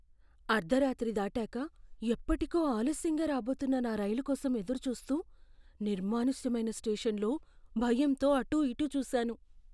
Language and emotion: Telugu, fearful